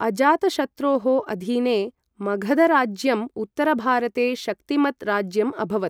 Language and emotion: Sanskrit, neutral